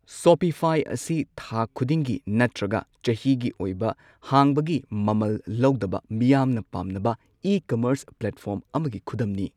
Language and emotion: Manipuri, neutral